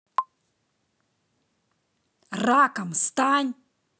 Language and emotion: Russian, angry